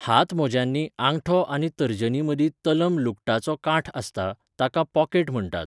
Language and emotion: Goan Konkani, neutral